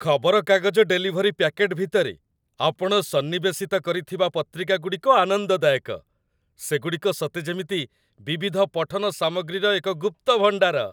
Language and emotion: Odia, happy